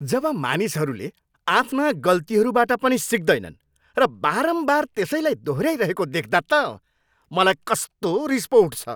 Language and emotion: Nepali, angry